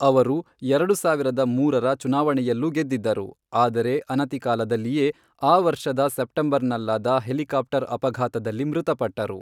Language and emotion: Kannada, neutral